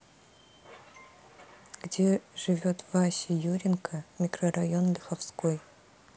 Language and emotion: Russian, neutral